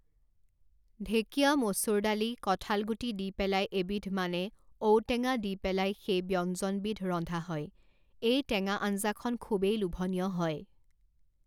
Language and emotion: Assamese, neutral